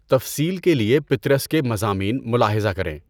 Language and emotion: Urdu, neutral